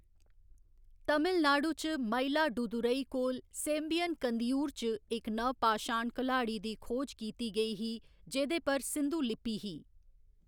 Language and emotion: Dogri, neutral